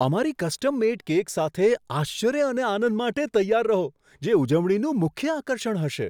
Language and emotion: Gujarati, surprised